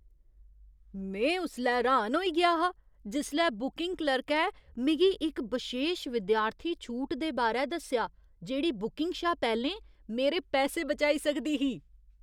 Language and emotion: Dogri, surprised